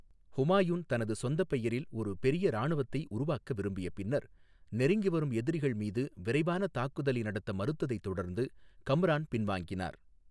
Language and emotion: Tamil, neutral